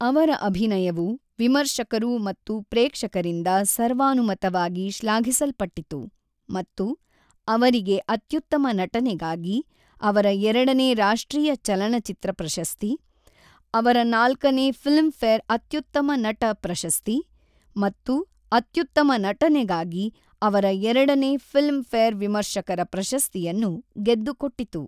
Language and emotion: Kannada, neutral